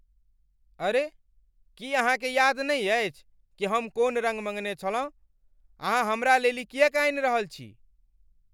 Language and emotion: Maithili, angry